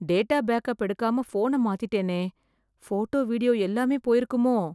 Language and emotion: Tamil, fearful